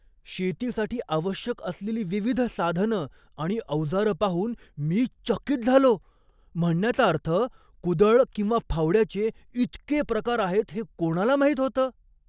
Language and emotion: Marathi, surprised